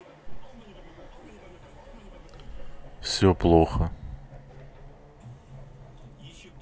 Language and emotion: Russian, sad